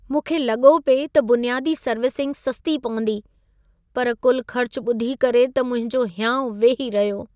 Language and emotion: Sindhi, sad